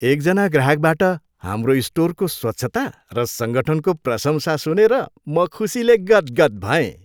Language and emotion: Nepali, happy